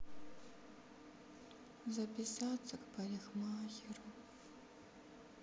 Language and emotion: Russian, sad